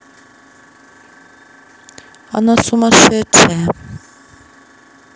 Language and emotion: Russian, neutral